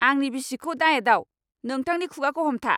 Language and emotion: Bodo, angry